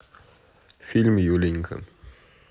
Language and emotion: Russian, neutral